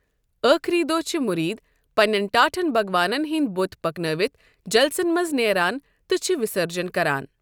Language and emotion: Kashmiri, neutral